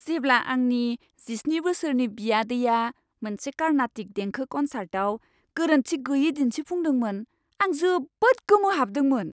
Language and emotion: Bodo, surprised